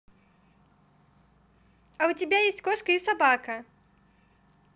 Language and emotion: Russian, positive